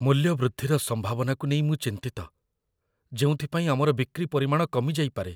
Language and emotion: Odia, fearful